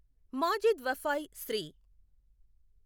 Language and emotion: Telugu, neutral